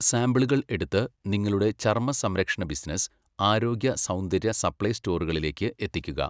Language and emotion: Malayalam, neutral